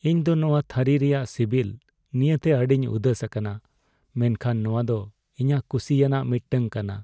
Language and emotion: Santali, sad